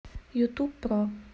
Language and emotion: Russian, neutral